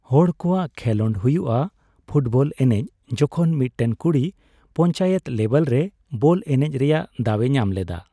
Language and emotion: Santali, neutral